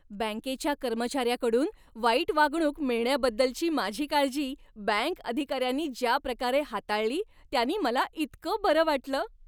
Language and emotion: Marathi, happy